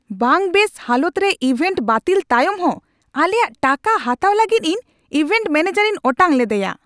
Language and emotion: Santali, angry